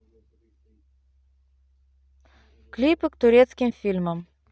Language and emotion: Russian, neutral